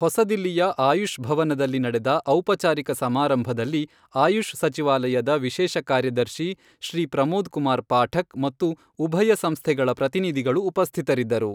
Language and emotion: Kannada, neutral